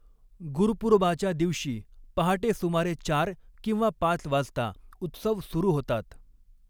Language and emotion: Marathi, neutral